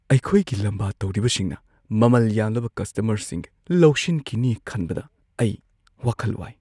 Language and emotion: Manipuri, fearful